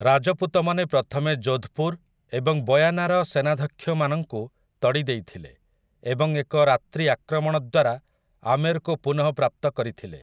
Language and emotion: Odia, neutral